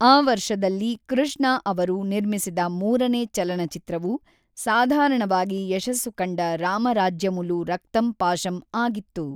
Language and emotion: Kannada, neutral